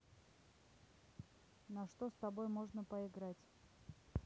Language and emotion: Russian, neutral